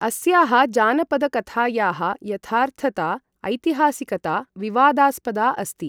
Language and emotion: Sanskrit, neutral